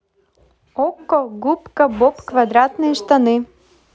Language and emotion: Russian, positive